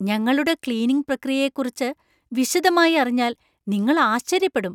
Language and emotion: Malayalam, surprised